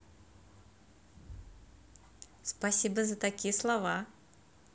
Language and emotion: Russian, positive